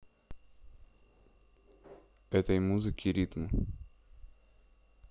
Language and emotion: Russian, neutral